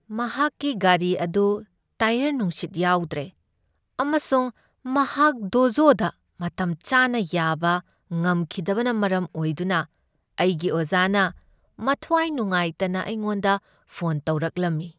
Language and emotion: Manipuri, sad